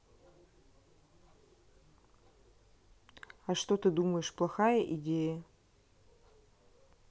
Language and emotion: Russian, neutral